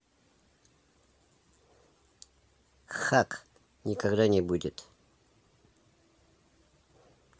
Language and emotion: Russian, neutral